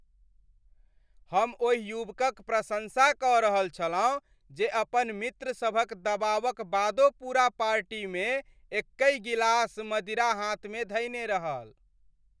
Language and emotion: Maithili, happy